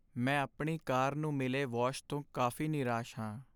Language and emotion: Punjabi, sad